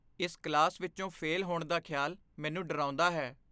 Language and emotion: Punjabi, fearful